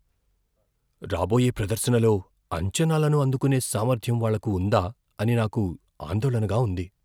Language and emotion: Telugu, fearful